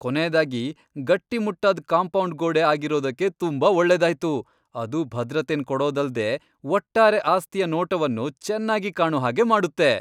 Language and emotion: Kannada, happy